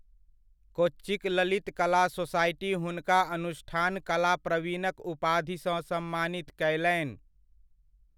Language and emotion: Maithili, neutral